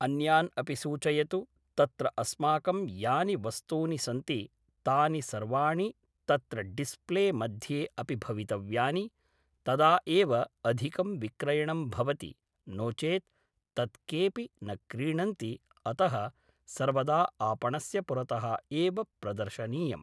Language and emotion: Sanskrit, neutral